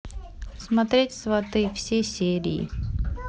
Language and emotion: Russian, neutral